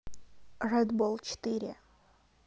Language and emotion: Russian, neutral